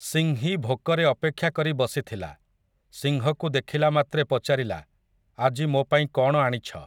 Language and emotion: Odia, neutral